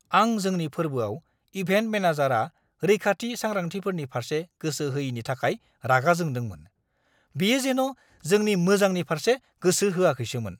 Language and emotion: Bodo, angry